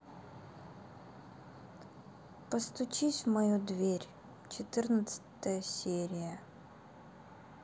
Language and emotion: Russian, sad